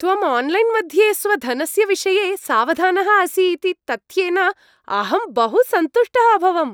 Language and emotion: Sanskrit, happy